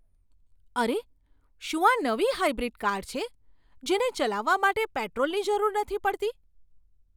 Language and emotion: Gujarati, surprised